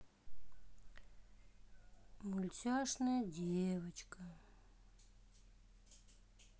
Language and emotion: Russian, sad